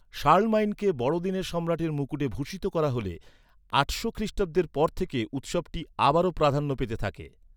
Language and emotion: Bengali, neutral